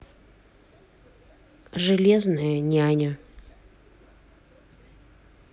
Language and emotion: Russian, neutral